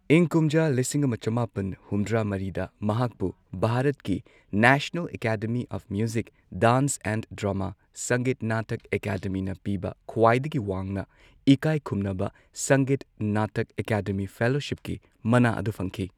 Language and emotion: Manipuri, neutral